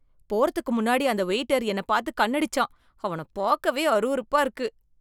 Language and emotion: Tamil, disgusted